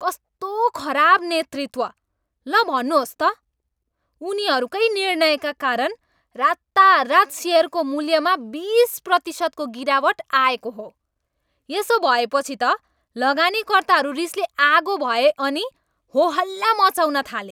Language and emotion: Nepali, angry